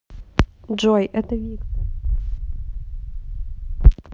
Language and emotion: Russian, neutral